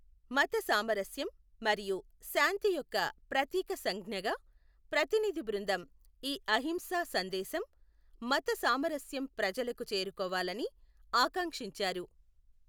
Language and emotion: Telugu, neutral